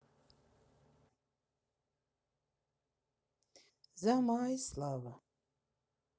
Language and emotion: Russian, sad